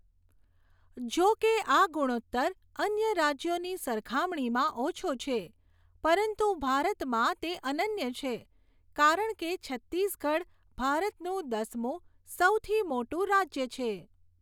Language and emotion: Gujarati, neutral